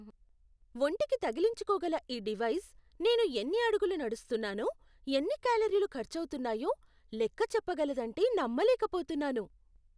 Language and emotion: Telugu, surprised